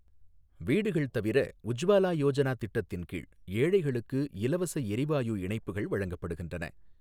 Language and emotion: Tamil, neutral